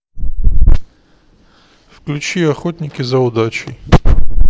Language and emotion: Russian, neutral